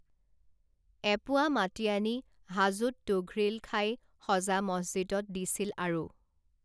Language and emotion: Assamese, neutral